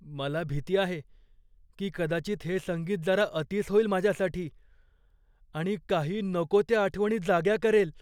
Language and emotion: Marathi, fearful